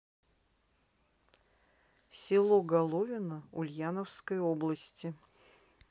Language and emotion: Russian, neutral